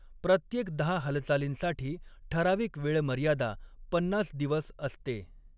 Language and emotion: Marathi, neutral